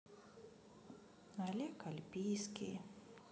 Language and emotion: Russian, sad